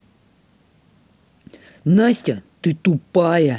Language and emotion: Russian, angry